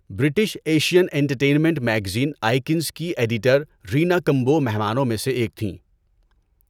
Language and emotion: Urdu, neutral